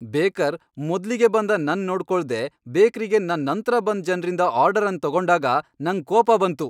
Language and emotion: Kannada, angry